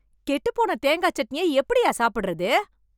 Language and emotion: Tamil, angry